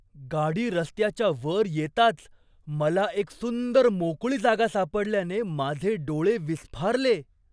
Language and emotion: Marathi, surprised